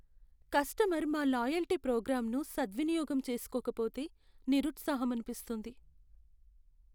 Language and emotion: Telugu, sad